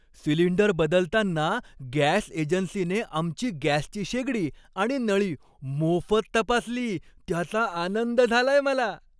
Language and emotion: Marathi, happy